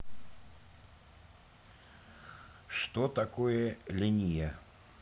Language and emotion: Russian, neutral